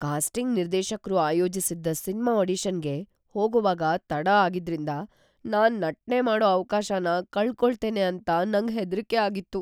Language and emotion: Kannada, fearful